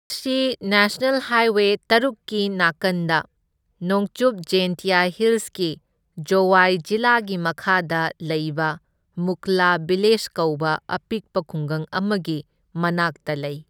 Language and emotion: Manipuri, neutral